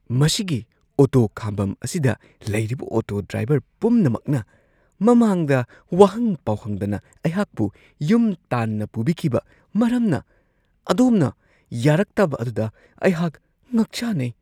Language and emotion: Manipuri, surprised